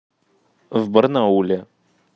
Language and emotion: Russian, neutral